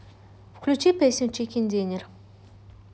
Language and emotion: Russian, neutral